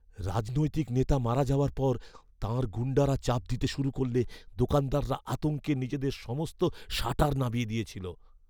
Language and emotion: Bengali, fearful